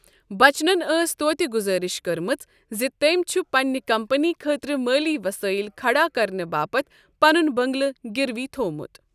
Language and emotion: Kashmiri, neutral